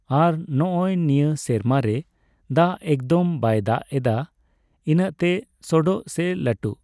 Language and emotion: Santali, neutral